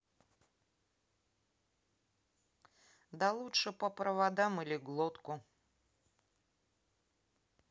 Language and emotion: Russian, neutral